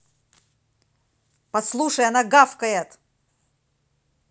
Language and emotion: Russian, angry